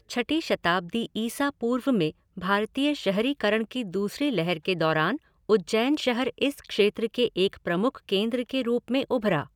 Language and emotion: Hindi, neutral